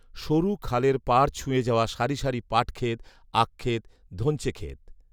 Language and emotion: Bengali, neutral